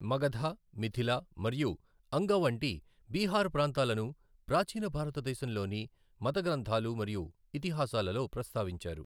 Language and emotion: Telugu, neutral